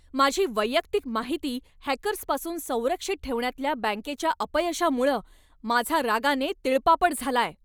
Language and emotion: Marathi, angry